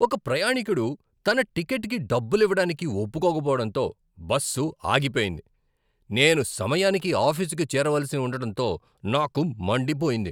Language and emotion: Telugu, angry